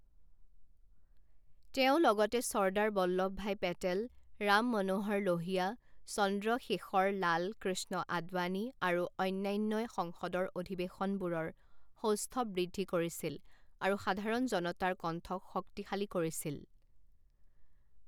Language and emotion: Assamese, neutral